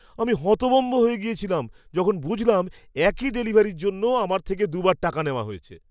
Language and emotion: Bengali, surprised